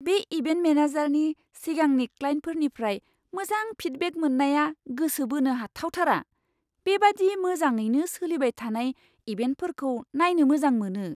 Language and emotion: Bodo, surprised